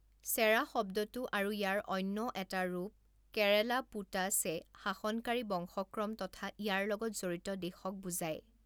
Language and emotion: Assamese, neutral